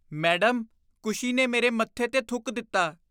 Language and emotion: Punjabi, disgusted